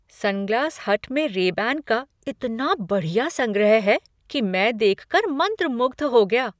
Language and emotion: Hindi, surprised